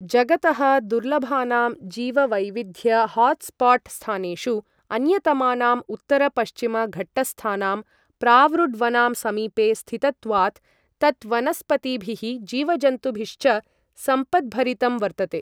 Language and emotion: Sanskrit, neutral